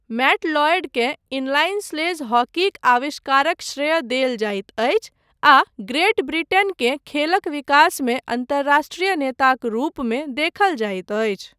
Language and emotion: Maithili, neutral